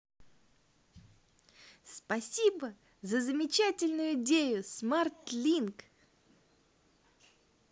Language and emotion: Russian, positive